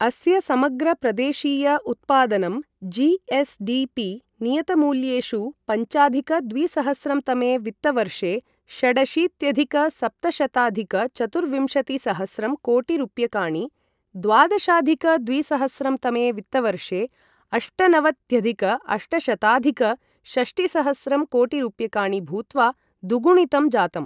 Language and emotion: Sanskrit, neutral